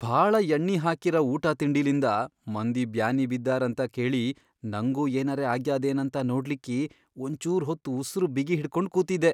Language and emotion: Kannada, fearful